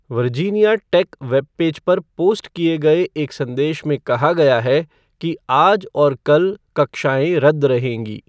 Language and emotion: Hindi, neutral